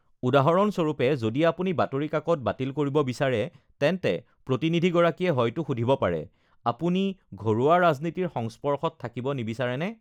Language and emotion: Assamese, neutral